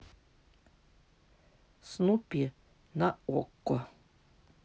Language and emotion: Russian, neutral